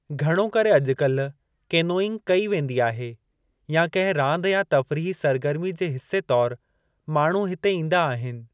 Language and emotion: Sindhi, neutral